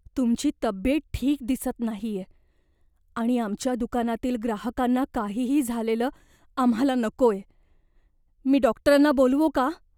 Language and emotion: Marathi, fearful